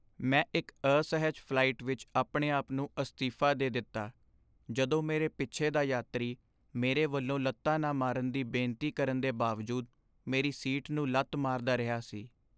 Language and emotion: Punjabi, sad